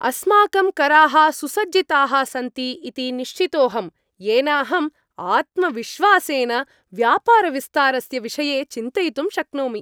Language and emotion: Sanskrit, happy